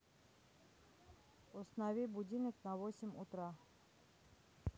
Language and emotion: Russian, neutral